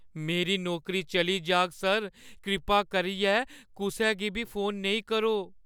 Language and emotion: Dogri, fearful